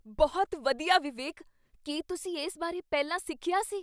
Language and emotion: Punjabi, surprised